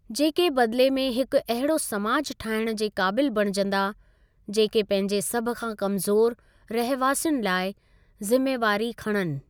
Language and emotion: Sindhi, neutral